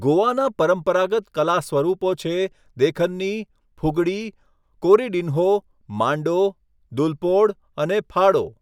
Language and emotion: Gujarati, neutral